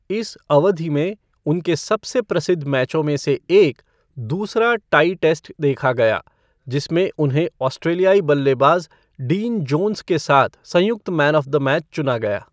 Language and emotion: Hindi, neutral